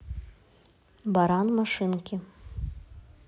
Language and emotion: Russian, neutral